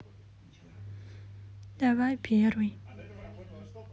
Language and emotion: Russian, sad